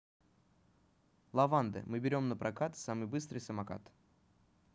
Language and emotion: Russian, neutral